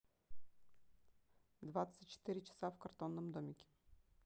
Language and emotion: Russian, neutral